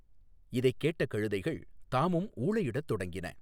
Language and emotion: Tamil, neutral